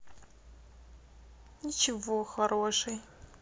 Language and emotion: Russian, sad